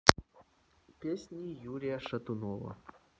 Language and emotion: Russian, neutral